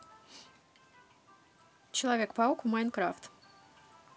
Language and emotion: Russian, positive